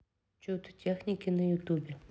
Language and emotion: Russian, neutral